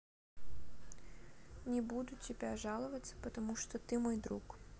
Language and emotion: Russian, neutral